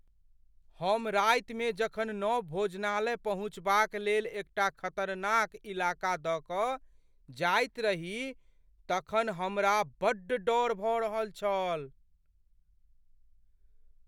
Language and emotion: Maithili, fearful